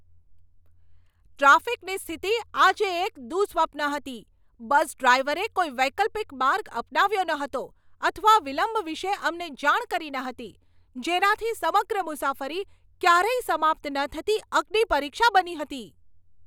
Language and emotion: Gujarati, angry